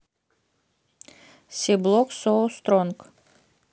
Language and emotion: Russian, neutral